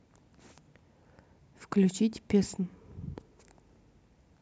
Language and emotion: Russian, neutral